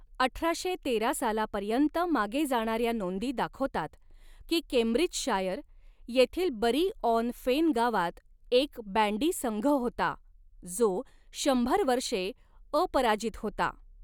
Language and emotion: Marathi, neutral